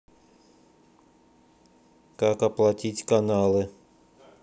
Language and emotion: Russian, neutral